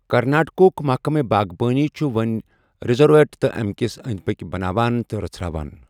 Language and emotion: Kashmiri, neutral